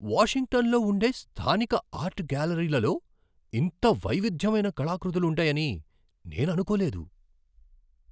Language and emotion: Telugu, surprised